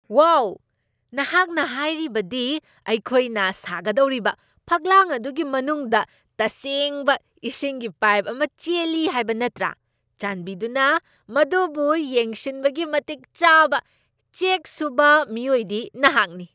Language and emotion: Manipuri, surprised